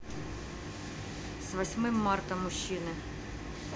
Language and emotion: Russian, neutral